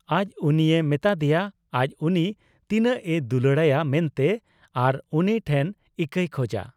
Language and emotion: Santali, neutral